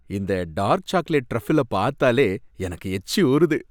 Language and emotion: Tamil, happy